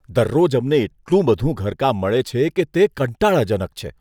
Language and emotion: Gujarati, disgusted